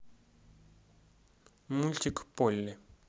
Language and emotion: Russian, neutral